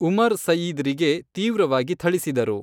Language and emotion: Kannada, neutral